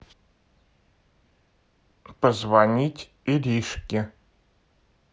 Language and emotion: Russian, neutral